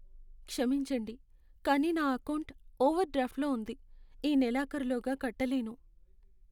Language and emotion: Telugu, sad